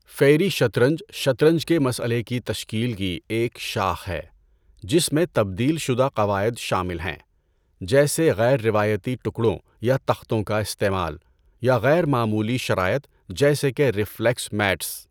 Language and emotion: Urdu, neutral